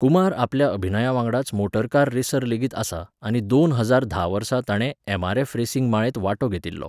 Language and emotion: Goan Konkani, neutral